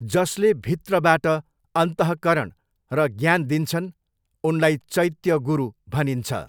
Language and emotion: Nepali, neutral